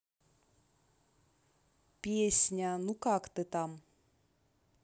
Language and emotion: Russian, neutral